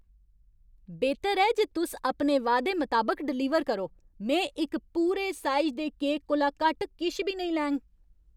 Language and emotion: Dogri, angry